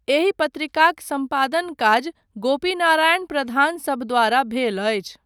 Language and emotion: Maithili, neutral